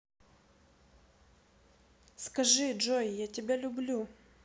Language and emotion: Russian, neutral